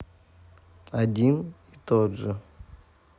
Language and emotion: Russian, neutral